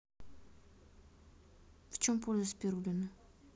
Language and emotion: Russian, neutral